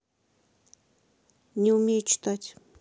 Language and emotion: Russian, neutral